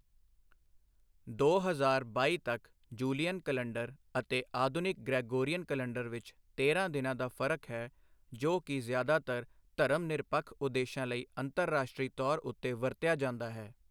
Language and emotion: Punjabi, neutral